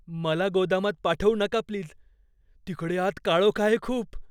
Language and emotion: Marathi, fearful